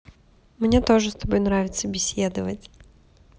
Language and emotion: Russian, positive